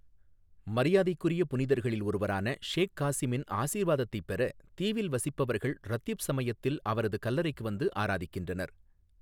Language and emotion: Tamil, neutral